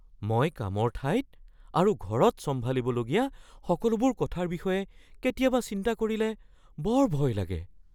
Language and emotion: Assamese, fearful